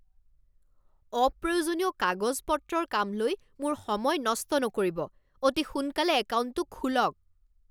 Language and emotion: Assamese, angry